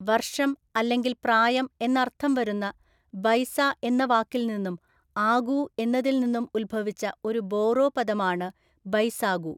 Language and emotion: Malayalam, neutral